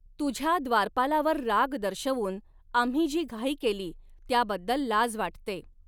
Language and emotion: Marathi, neutral